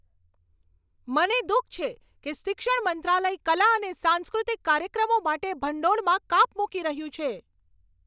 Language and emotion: Gujarati, angry